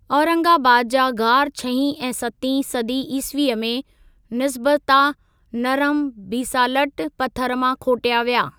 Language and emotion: Sindhi, neutral